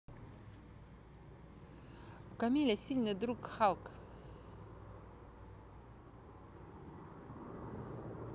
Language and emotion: Russian, neutral